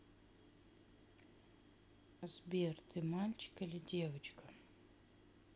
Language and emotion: Russian, sad